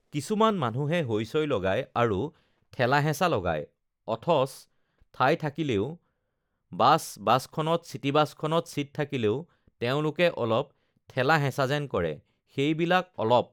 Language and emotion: Assamese, neutral